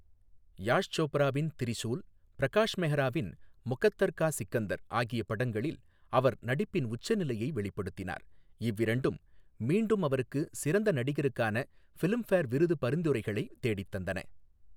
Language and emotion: Tamil, neutral